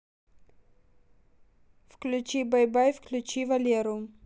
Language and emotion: Russian, neutral